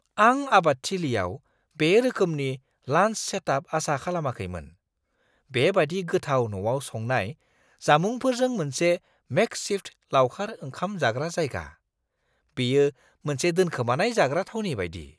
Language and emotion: Bodo, surprised